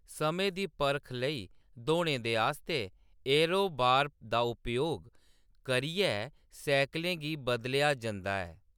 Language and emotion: Dogri, neutral